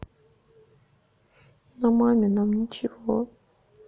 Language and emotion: Russian, sad